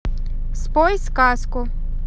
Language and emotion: Russian, neutral